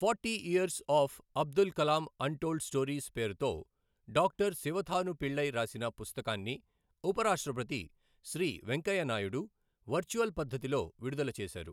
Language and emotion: Telugu, neutral